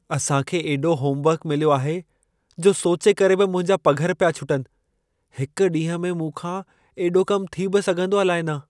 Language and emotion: Sindhi, fearful